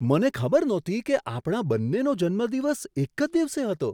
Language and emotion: Gujarati, surprised